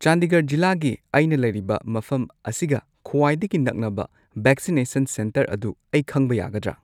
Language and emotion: Manipuri, neutral